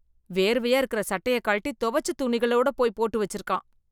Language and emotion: Tamil, disgusted